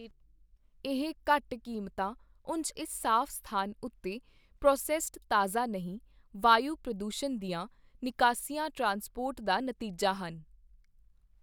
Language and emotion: Punjabi, neutral